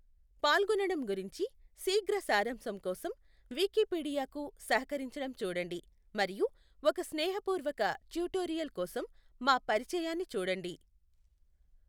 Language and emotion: Telugu, neutral